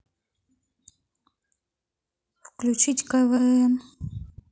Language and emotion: Russian, neutral